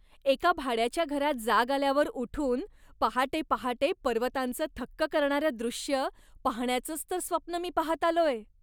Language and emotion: Marathi, happy